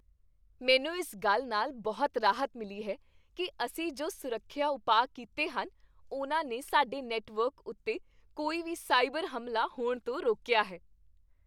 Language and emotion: Punjabi, happy